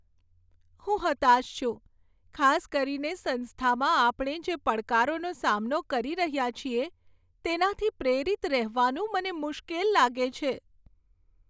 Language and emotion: Gujarati, sad